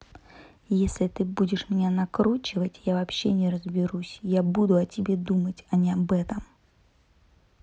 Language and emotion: Russian, angry